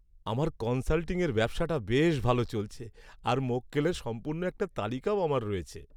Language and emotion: Bengali, happy